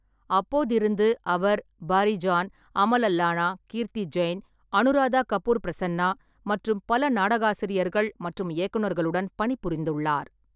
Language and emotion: Tamil, neutral